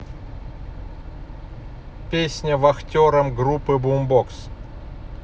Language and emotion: Russian, neutral